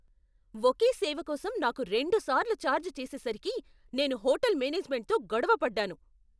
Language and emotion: Telugu, angry